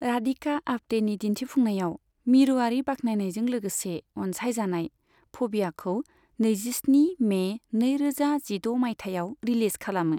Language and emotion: Bodo, neutral